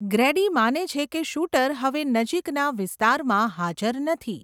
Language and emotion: Gujarati, neutral